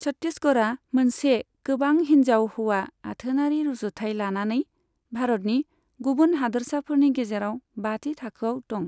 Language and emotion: Bodo, neutral